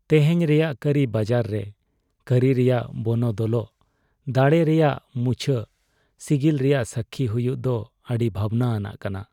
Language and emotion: Santali, sad